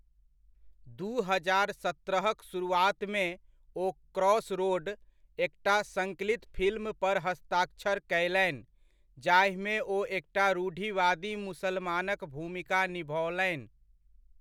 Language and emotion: Maithili, neutral